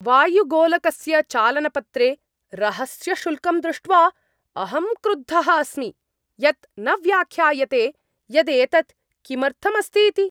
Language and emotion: Sanskrit, angry